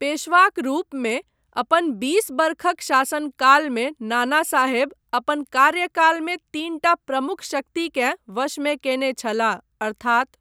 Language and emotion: Maithili, neutral